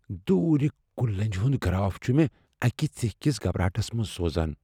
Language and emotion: Kashmiri, fearful